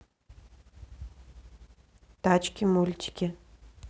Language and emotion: Russian, neutral